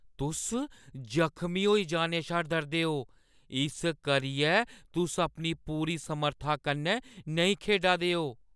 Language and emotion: Dogri, fearful